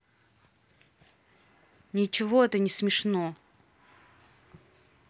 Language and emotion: Russian, angry